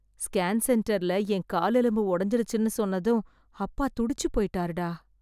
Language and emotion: Tamil, sad